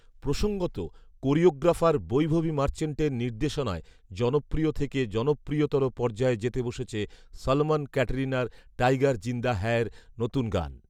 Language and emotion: Bengali, neutral